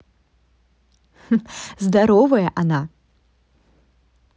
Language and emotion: Russian, positive